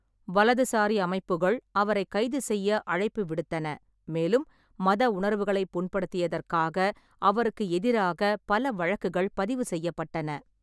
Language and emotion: Tamil, neutral